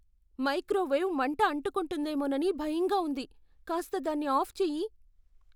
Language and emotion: Telugu, fearful